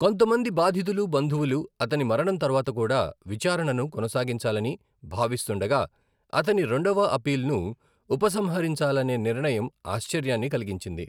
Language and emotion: Telugu, neutral